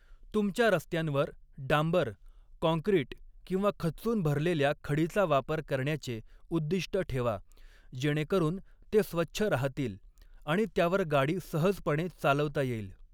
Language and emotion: Marathi, neutral